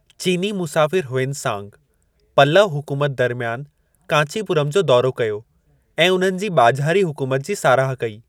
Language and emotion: Sindhi, neutral